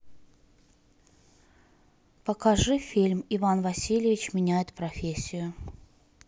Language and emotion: Russian, neutral